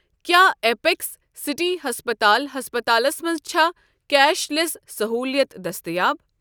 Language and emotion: Kashmiri, neutral